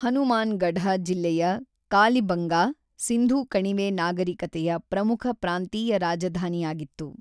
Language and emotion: Kannada, neutral